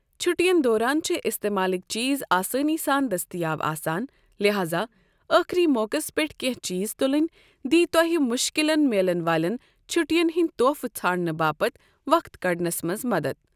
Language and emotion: Kashmiri, neutral